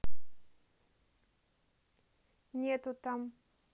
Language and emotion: Russian, neutral